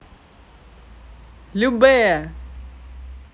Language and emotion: Russian, positive